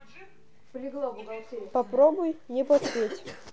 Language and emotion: Russian, neutral